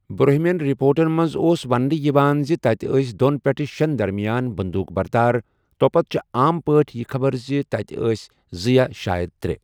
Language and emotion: Kashmiri, neutral